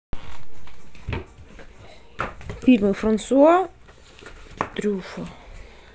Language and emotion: Russian, neutral